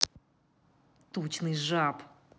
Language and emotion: Russian, angry